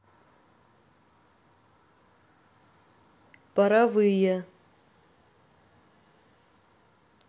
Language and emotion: Russian, neutral